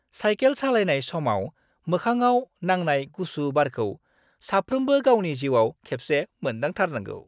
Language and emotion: Bodo, happy